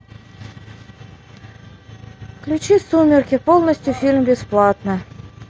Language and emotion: Russian, neutral